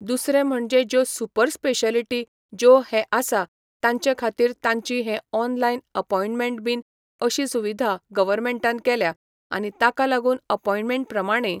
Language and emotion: Goan Konkani, neutral